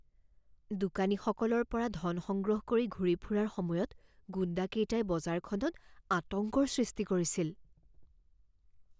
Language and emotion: Assamese, fearful